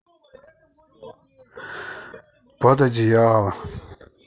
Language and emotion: Russian, sad